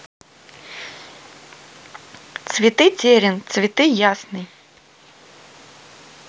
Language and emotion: Russian, neutral